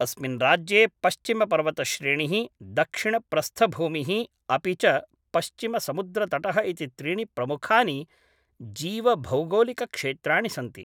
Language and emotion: Sanskrit, neutral